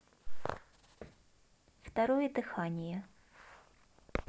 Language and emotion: Russian, neutral